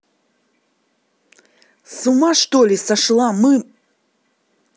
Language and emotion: Russian, angry